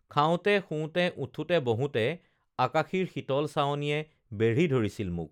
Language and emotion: Assamese, neutral